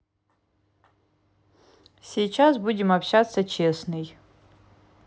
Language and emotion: Russian, neutral